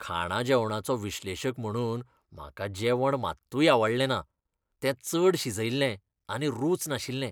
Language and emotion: Goan Konkani, disgusted